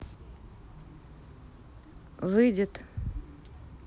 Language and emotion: Russian, neutral